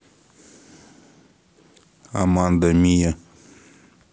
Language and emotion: Russian, neutral